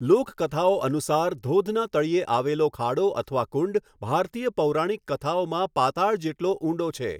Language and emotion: Gujarati, neutral